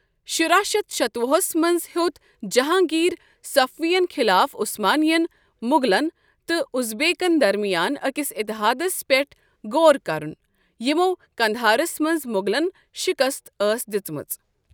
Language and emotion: Kashmiri, neutral